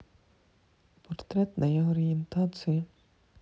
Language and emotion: Russian, sad